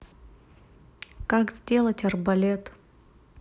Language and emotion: Russian, neutral